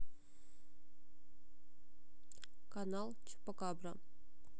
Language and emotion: Russian, neutral